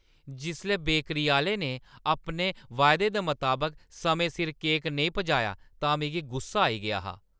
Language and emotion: Dogri, angry